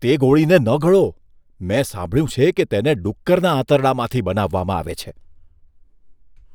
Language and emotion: Gujarati, disgusted